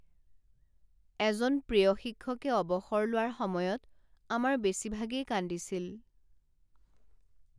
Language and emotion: Assamese, sad